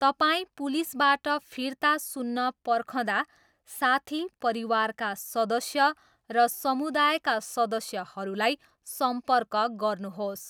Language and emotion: Nepali, neutral